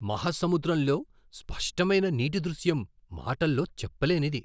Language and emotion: Telugu, surprised